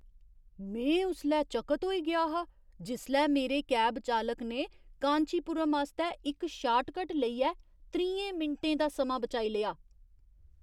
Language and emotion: Dogri, surprised